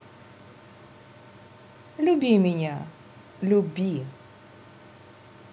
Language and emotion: Russian, positive